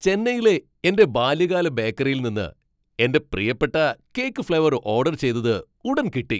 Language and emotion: Malayalam, happy